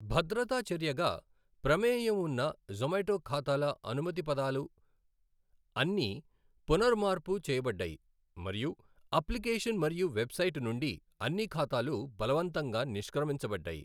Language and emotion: Telugu, neutral